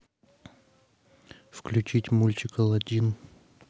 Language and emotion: Russian, neutral